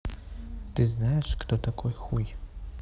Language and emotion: Russian, neutral